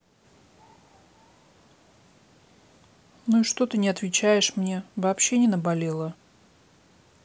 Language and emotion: Russian, neutral